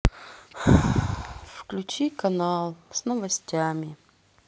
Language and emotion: Russian, sad